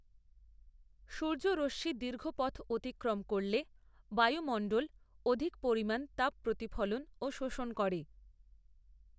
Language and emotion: Bengali, neutral